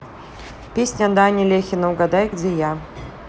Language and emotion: Russian, neutral